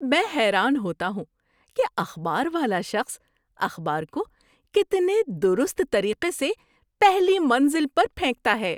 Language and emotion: Urdu, surprised